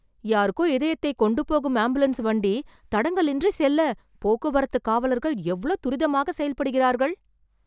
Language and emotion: Tamil, surprised